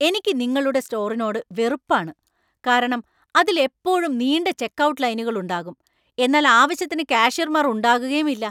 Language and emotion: Malayalam, angry